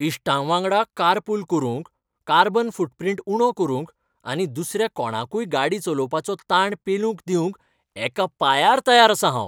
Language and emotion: Goan Konkani, happy